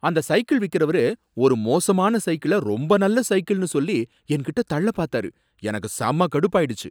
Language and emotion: Tamil, angry